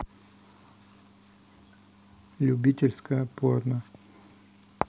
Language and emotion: Russian, neutral